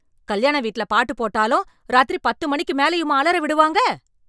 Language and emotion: Tamil, angry